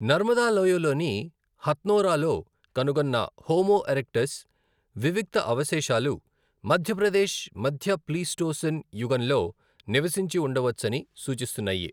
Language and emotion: Telugu, neutral